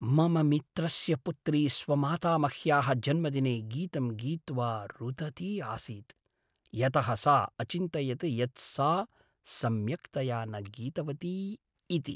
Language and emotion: Sanskrit, sad